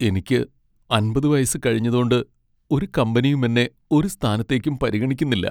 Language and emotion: Malayalam, sad